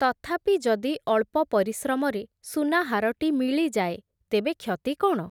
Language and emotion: Odia, neutral